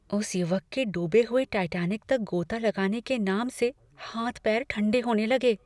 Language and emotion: Hindi, fearful